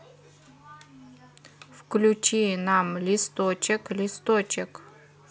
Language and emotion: Russian, neutral